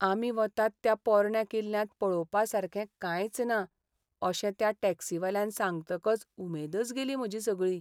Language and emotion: Goan Konkani, sad